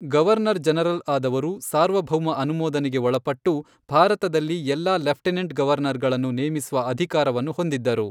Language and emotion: Kannada, neutral